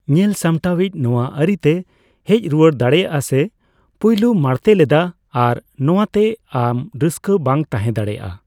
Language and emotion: Santali, neutral